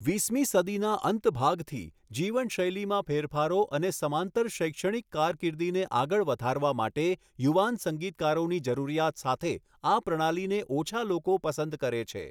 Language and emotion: Gujarati, neutral